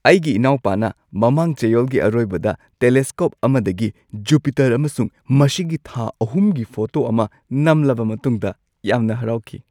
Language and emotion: Manipuri, happy